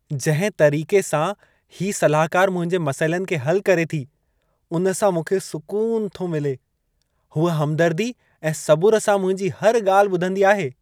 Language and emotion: Sindhi, happy